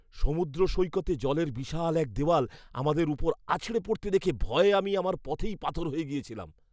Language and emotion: Bengali, fearful